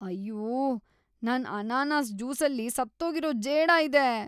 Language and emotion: Kannada, disgusted